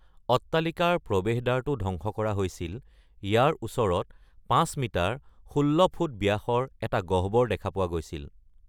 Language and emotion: Assamese, neutral